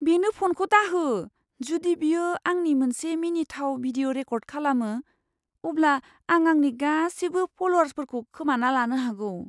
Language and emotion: Bodo, fearful